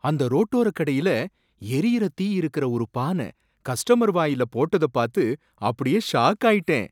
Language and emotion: Tamil, surprised